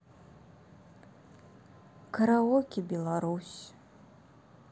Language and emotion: Russian, sad